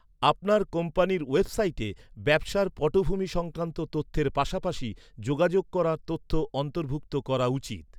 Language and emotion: Bengali, neutral